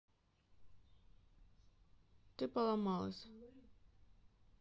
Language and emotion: Russian, neutral